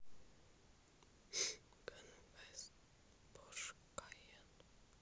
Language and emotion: Russian, sad